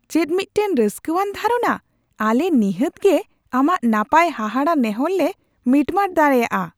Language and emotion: Santali, surprised